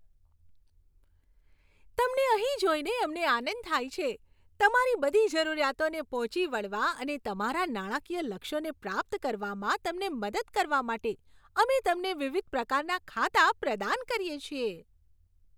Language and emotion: Gujarati, happy